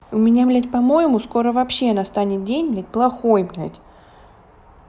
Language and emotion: Russian, angry